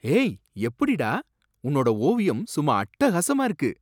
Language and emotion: Tamil, surprised